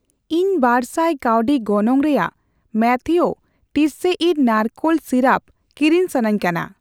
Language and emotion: Santali, neutral